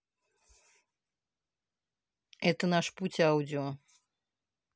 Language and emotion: Russian, neutral